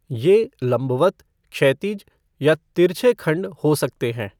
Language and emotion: Hindi, neutral